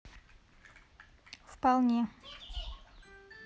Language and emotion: Russian, neutral